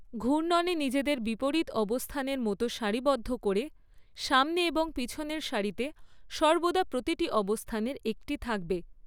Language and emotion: Bengali, neutral